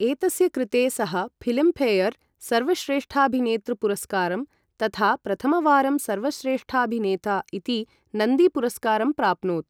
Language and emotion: Sanskrit, neutral